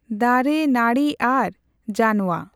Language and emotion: Santali, neutral